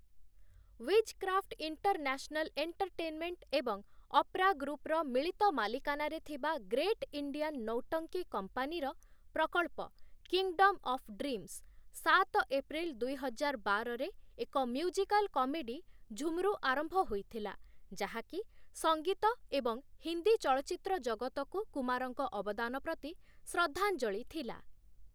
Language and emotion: Odia, neutral